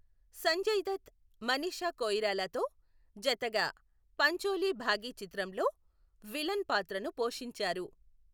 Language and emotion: Telugu, neutral